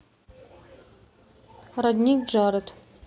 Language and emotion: Russian, neutral